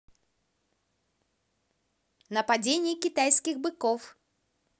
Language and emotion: Russian, positive